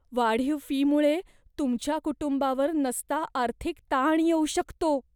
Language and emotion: Marathi, fearful